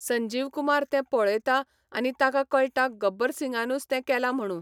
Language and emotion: Goan Konkani, neutral